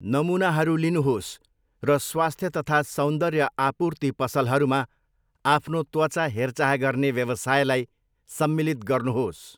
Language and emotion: Nepali, neutral